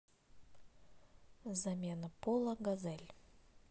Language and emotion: Russian, neutral